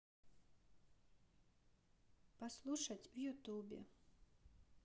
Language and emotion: Russian, neutral